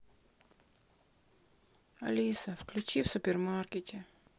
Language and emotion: Russian, sad